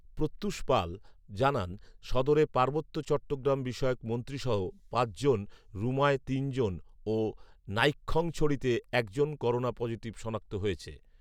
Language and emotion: Bengali, neutral